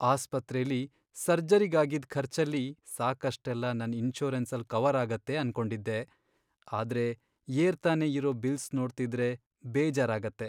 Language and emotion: Kannada, sad